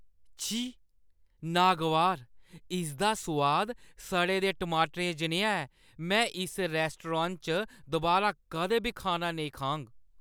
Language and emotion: Dogri, disgusted